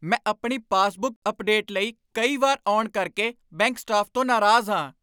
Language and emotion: Punjabi, angry